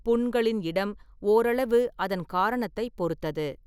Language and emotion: Tamil, neutral